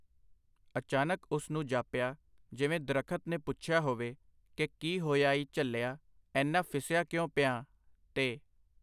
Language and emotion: Punjabi, neutral